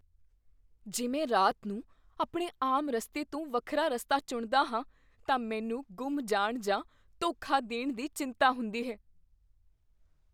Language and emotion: Punjabi, fearful